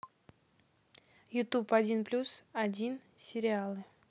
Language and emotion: Russian, neutral